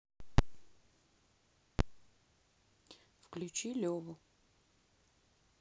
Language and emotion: Russian, neutral